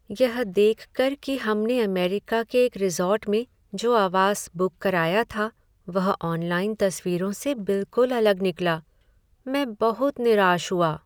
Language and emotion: Hindi, sad